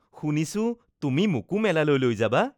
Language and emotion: Assamese, happy